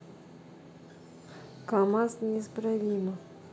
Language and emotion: Russian, neutral